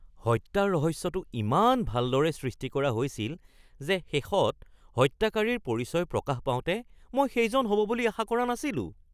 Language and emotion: Assamese, surprised